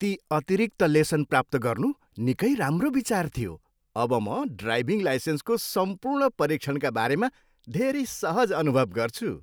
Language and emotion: Nepali, happy